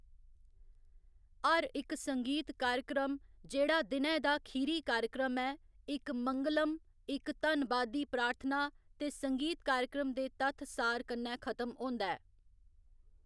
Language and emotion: Dogri, neutral